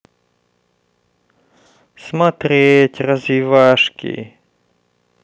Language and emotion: Russian, sad